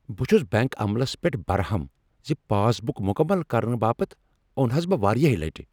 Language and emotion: Kashmiri, angry